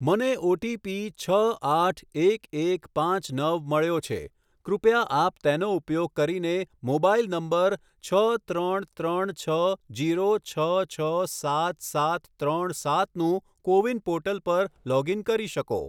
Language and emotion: Gujarati, neutral